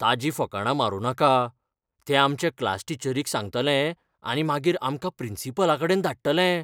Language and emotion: Goan Konkani, fearful